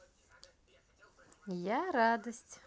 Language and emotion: Russian, positive